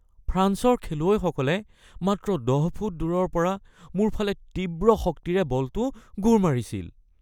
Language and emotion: Assamese, fearful